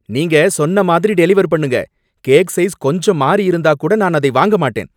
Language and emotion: Tamil, angry